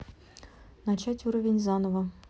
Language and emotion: Russian, neutral